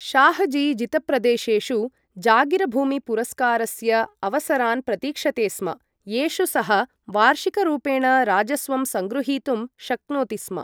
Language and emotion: Sanskrit, neutral